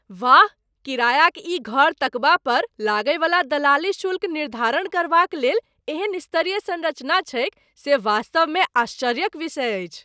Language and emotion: Maithili, surprised